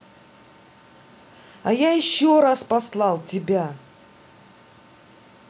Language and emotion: Russian, angry